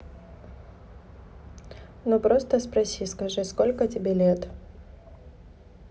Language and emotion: Russian, neutral